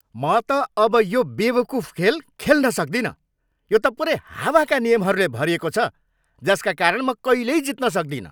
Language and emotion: Nepali, angry